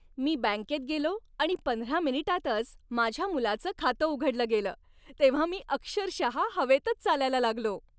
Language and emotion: Marathi, happy